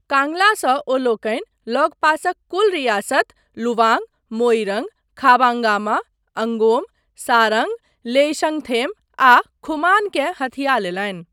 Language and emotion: Maithili, neutral